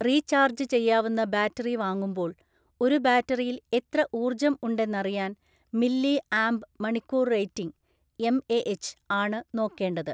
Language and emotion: Malayalam, neutral